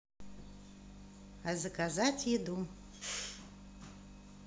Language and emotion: Russian, positive